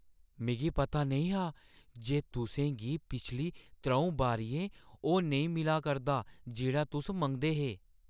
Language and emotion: Dogri, surprised